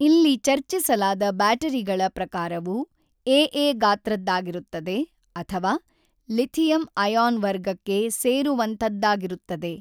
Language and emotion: Kannada, neutral